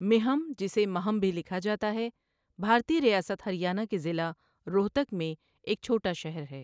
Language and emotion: Urdu, neutral